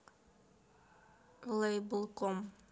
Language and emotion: Russian, neutral